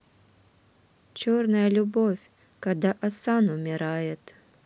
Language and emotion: Russian, neutral